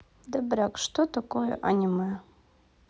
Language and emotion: Russian, neutral